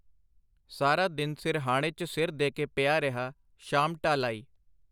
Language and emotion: Punjabi, neutral